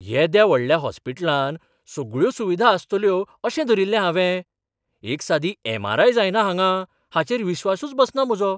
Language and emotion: Goan Konkani, surprised